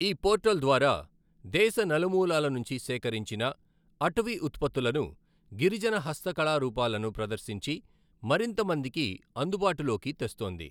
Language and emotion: Telugu, neutral